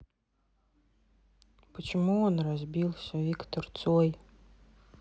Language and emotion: Russian, sad